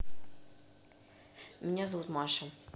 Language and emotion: Russian, neutral